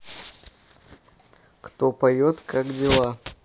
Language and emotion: Russian, neutral